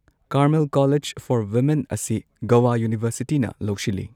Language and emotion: Manipuri, neutral